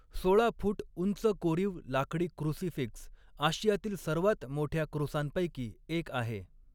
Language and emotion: Marathi, neutral